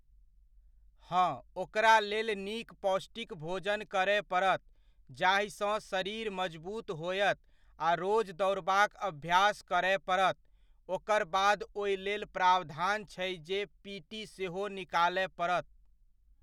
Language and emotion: Maithili, neutral